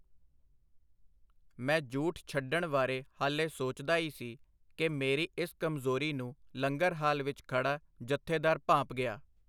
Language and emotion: Punjabi, neutral